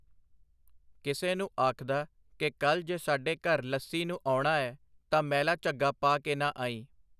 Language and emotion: Punjabi, neutral